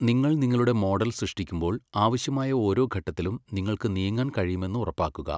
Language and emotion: Malayalam, neutral